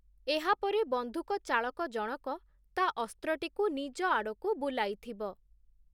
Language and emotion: Odia, neutral